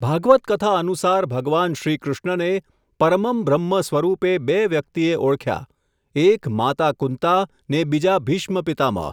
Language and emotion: Gujarati, neutral